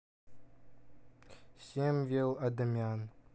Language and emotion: Russian, neutral